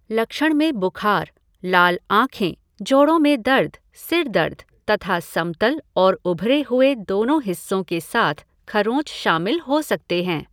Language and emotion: Hindi, neutral